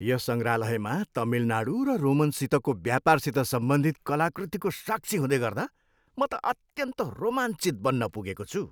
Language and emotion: Nepali, happy